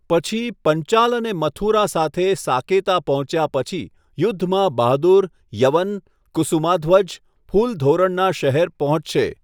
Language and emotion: Gujarati, neutral